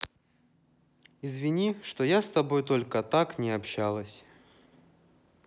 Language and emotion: Russian, sad